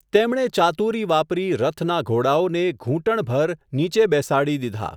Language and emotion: Gujarati, neutral